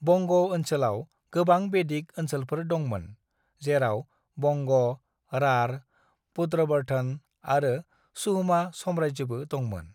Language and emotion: Bodo, neutral